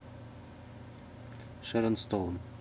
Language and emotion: Russian, neutral